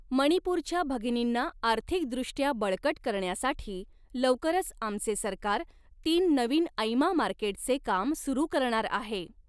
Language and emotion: Marathi, neutral